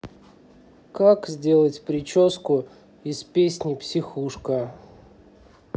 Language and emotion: Russian, neutral